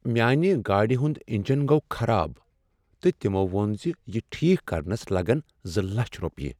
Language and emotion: Kashmiri, sad